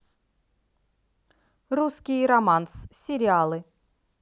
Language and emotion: Russian, positive